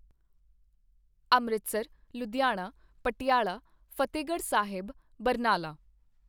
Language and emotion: Punjabi, neutral